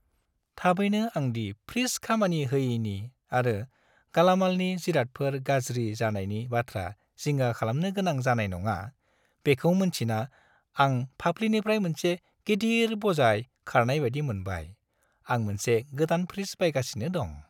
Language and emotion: Bodo, happy